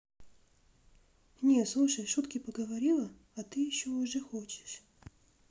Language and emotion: Russian, neutral